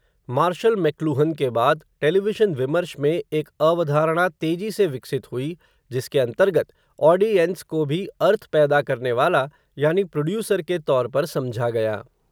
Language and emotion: Hindi, neutral